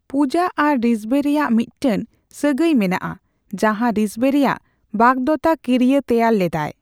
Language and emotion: Santali, neutral